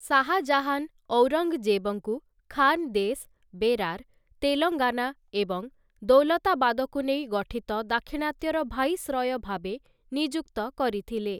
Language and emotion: Odia, neutral